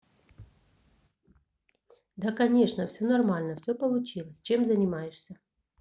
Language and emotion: Russian, neutral